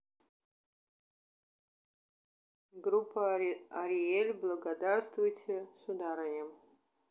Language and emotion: Russian, neutral